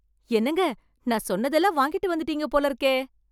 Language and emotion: Tamil, surprised